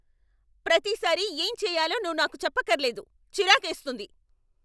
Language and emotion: Telugu, angry